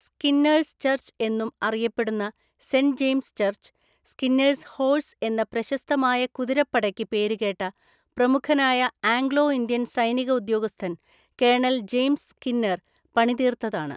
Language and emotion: Malayalam, neutral